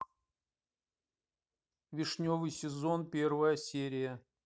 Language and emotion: Russian, neutral